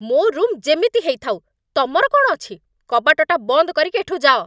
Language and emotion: Odia, angry